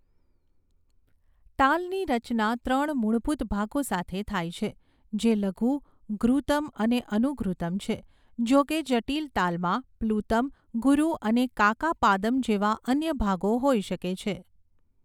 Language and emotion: Gujarati, neutral